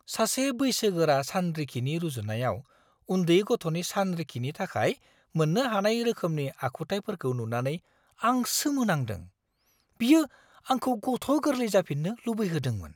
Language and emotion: Bodo, surprised